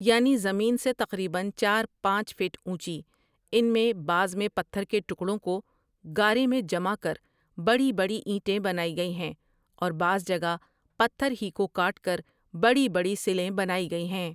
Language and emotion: Urdu, neutral